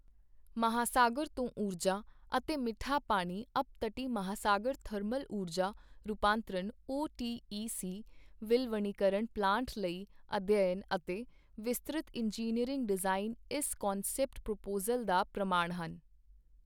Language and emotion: Punjabi, neutral